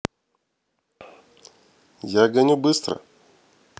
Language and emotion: Russian, neutral